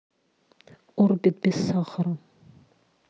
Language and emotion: Russian, neutral